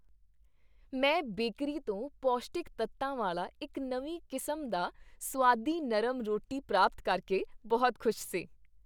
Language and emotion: Punjabi, happy